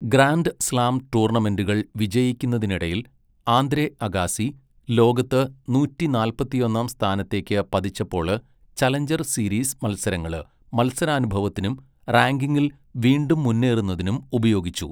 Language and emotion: Malayalam, neutral